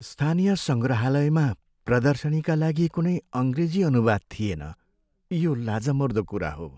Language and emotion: Nepali, sad